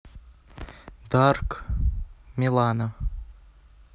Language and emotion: Russian, neutral